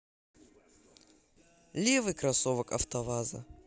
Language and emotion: Russian, positive